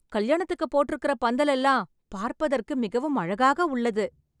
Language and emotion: Tamil, happy